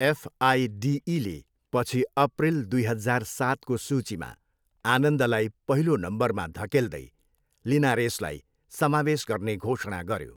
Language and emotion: Nepali, neutral